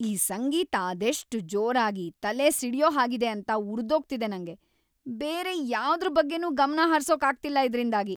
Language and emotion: Kannada, angry